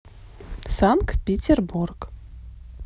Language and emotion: Russian, neutral